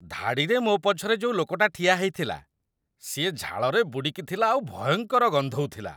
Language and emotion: Odia, disgusted